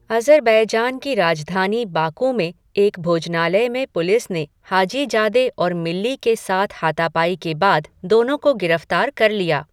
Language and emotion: Hindi, neutral